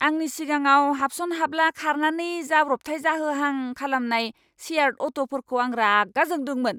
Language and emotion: Bodo, angry